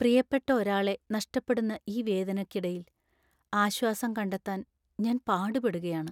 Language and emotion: Malayalam, sad